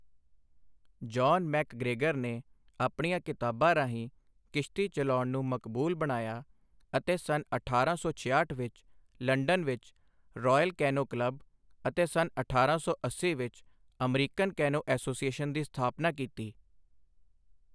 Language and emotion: Punjabi, neutral